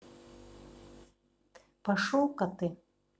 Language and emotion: Russian, angry